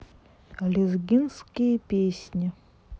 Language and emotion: Russian, neutral